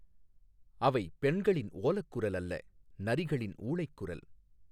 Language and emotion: Tamil, neutral